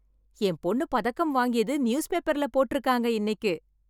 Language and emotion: Tamil, happy